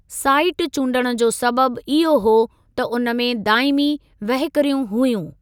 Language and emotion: Sindhi, neutral